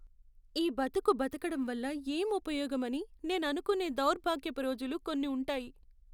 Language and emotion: Telugu, sad